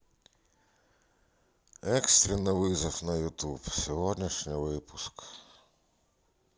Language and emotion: Russian, sad